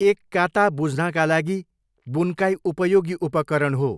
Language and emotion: Nepali, neutral